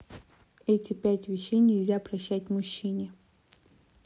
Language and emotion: Russian, neutral